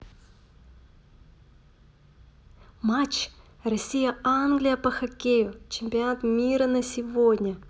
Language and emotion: Russian, positive